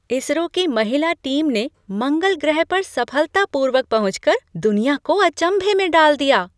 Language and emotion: Hindi, surprised